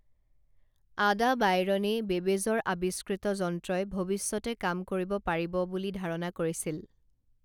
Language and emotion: Assamese, neutral